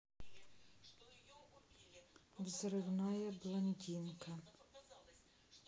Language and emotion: Russian, neutral